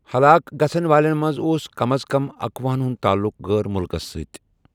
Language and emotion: Kashmiri, neutral